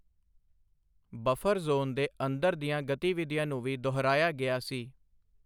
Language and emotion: Punjabi, neutral